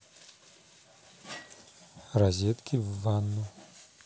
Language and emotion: Russian, neutral